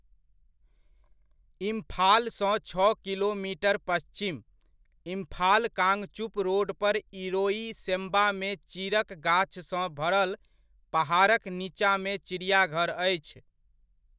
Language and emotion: Maithili, neutral